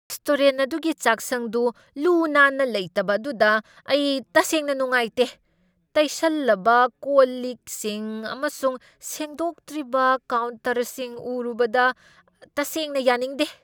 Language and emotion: Manipuri, angry